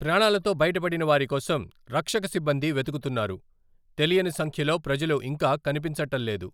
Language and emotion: Telugu, neutral